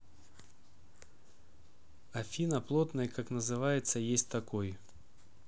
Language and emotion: Russian, neutral